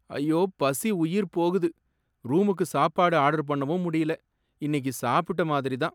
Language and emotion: Tamil, sad